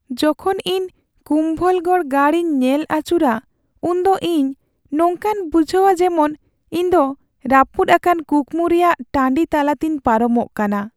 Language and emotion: Santali, sad